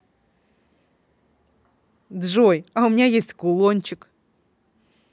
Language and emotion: Russian, positive